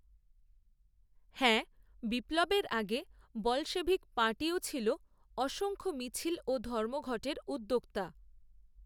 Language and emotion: Bengali, neutral